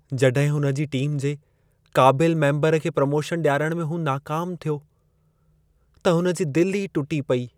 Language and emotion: Sindhi, sad